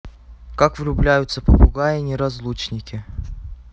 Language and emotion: Russian, neutral